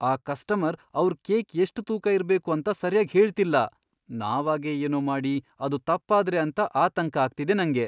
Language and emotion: Kannada, fearful